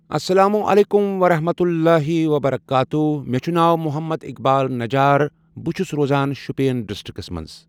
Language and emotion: Kashmiri, neutral